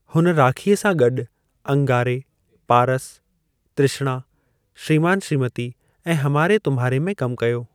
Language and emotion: Sindhi, neutral